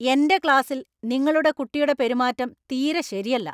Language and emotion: Malayalam, angry